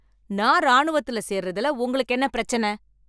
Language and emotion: Tamil, angry